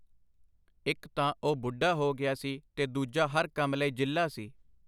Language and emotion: Punjabi, neutral